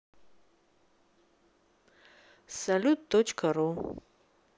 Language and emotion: Russian, neutral